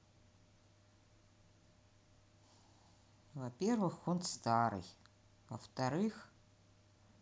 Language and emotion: Russian, neutral